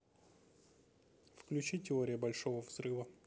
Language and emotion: Russian, neutral